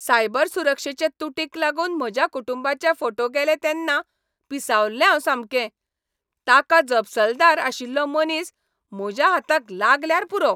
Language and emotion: Goan Konkani, angry